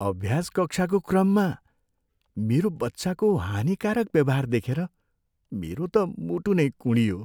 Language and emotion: Nepali, sad